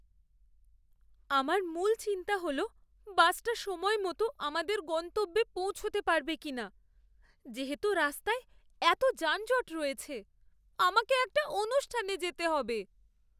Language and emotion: Bengali, fearful